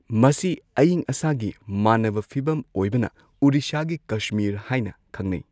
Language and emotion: Manipuri, neutral